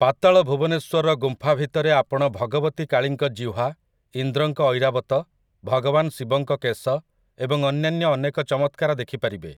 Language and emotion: Odia, neutral